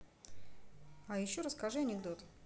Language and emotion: Russian, neutral